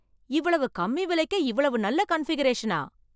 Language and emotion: Tamil, surprised